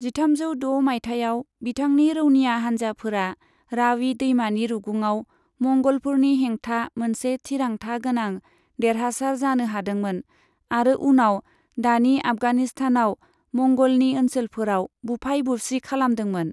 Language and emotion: Bodo, neutral